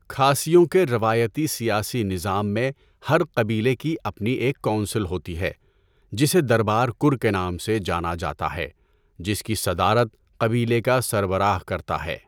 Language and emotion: Urdu, neutral